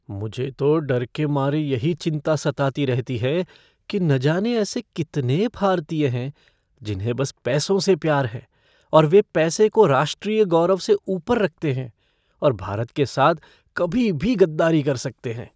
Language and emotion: Hindi, fearful